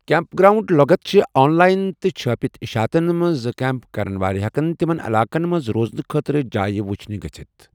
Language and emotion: Kashmiri, neutral